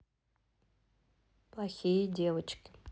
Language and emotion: Russian, neutral